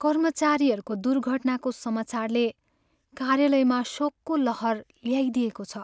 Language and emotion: Nepali, sad